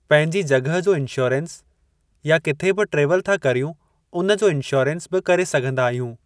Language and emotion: Sindhi, neutral